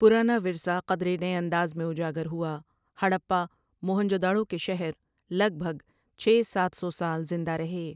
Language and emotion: Urdu, neutral